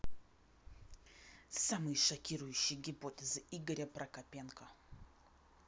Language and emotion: Russian, angry